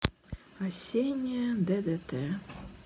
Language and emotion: Russian, sad